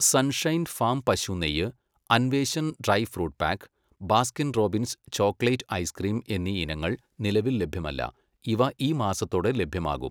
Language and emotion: Malayalam, neutral